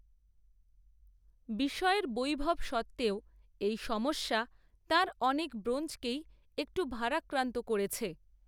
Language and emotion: Bengali, neutral